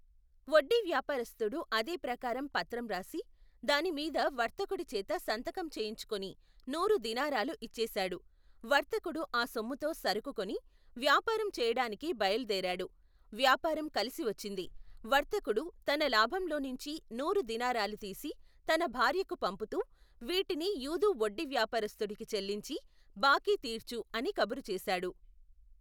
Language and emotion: Telugu, neutral